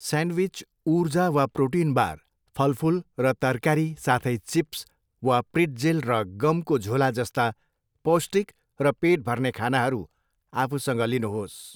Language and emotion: Nepali, neutral